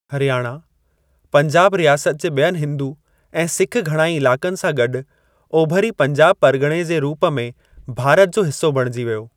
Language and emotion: Sindhi, neutral